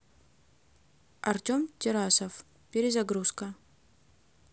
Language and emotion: Russian, neutral